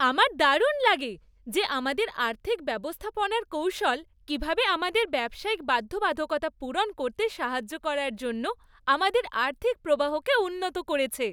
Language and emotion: Bengali, happy